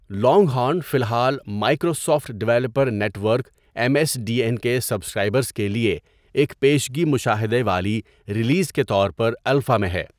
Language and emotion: Urdu, neutral